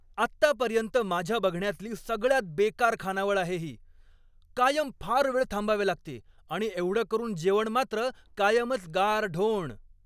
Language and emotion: Marathi, angry